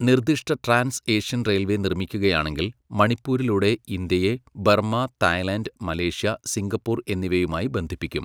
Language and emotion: Malayalam, neutral